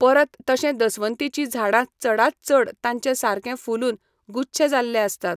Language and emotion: Goan Konkani, neutral